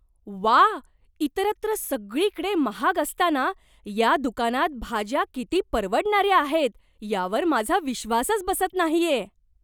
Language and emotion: Marathi, surprised